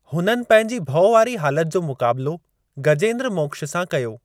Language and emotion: Sindhi, neutral